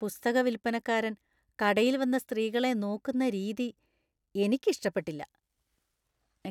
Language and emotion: Malayalam, disgusted